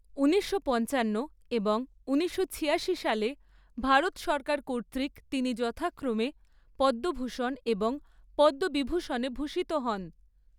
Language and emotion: Bengali, neutral